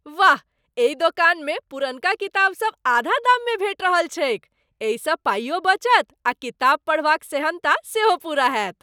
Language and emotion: Maithili, happy